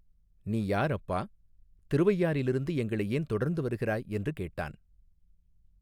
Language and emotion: Tamil, neutral